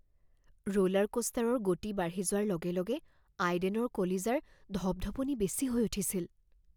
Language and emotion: Assamese, fearful